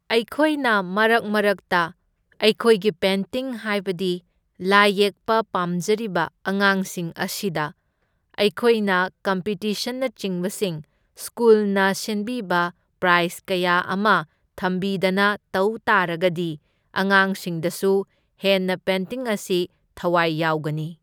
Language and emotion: Manipuri, neutral